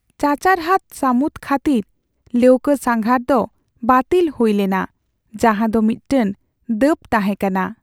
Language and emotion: Santali, sad